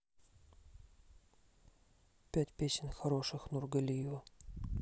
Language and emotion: Russian, neutral